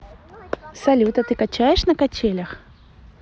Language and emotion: Russian, positive